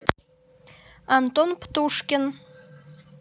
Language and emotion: Russian, neutral